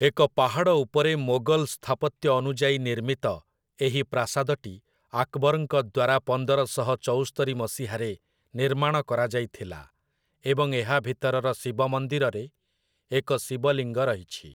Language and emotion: Odia, neutral